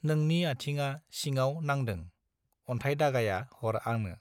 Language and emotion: Bodo, neutral